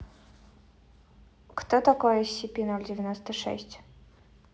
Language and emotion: Russian, neutral